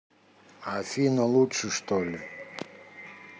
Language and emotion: Russian, angry